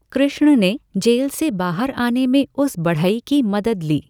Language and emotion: Hindi, neutral